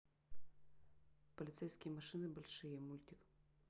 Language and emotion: Russian, neutral